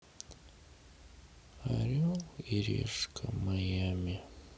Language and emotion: Russian, sad